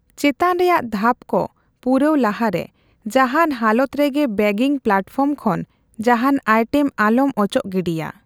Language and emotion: Santali, neutral